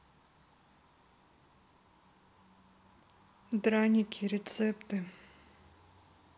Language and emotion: Russian, neutral